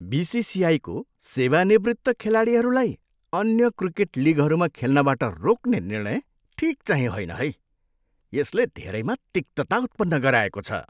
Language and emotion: Nepali, disgusted